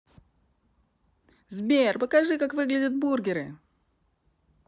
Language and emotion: Russian, positive